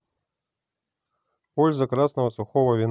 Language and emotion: Russian, neutral